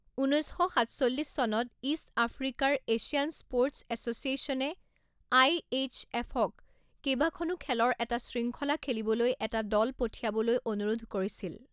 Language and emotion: Assamese, neutral